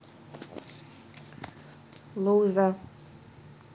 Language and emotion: Russian, neutral